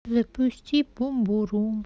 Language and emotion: Russian, sad